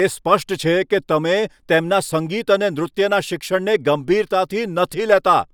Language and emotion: Gujarati, angry